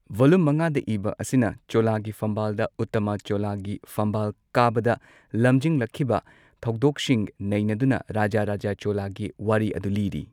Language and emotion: Manipuri, neutral